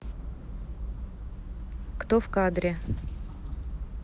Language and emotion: Russian, neutral